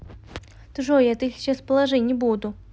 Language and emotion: Russian, neutral